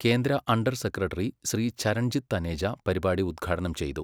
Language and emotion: Malayalam, neutral